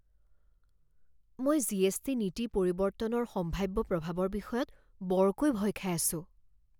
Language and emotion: Assamese, fearful